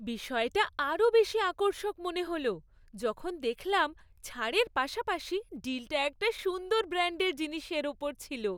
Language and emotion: Bengali, happy